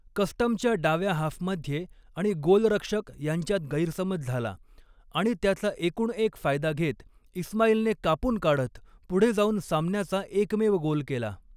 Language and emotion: Marathi, neutral